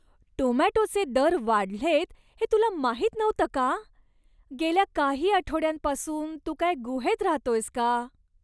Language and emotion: Marathi, disgusted